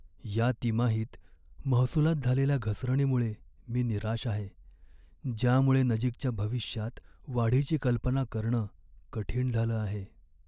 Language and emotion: Marathi, sad